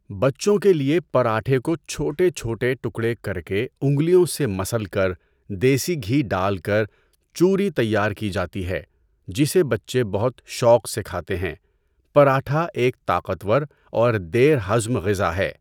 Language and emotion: Urdu, neutral